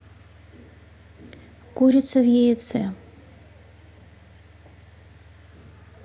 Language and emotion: Russian, neutral